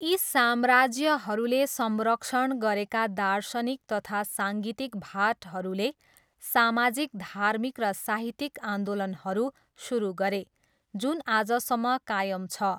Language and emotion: Nepali, neutral